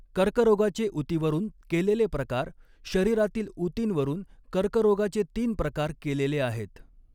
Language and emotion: Marathi, neutral